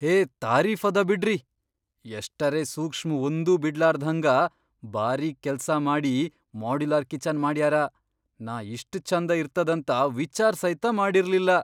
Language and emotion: Kannada, surprised